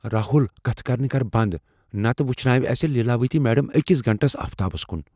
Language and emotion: Kashmiri, fearful